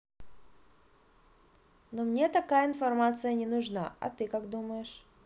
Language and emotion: Russian, neutral